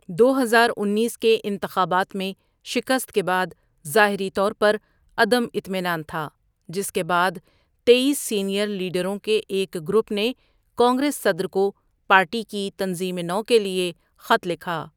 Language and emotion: Urdu, neutral